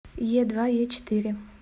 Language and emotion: Russian, neutral